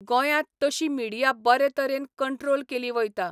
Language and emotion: Goan Konkani, neutral